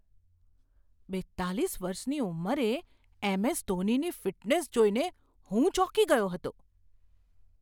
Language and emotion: Gujarati, surprised